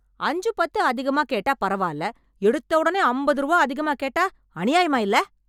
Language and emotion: Tamil, angry